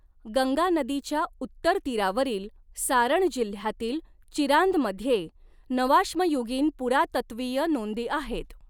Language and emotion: Marathi, neutral